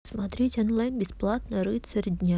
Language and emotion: Russian, neutral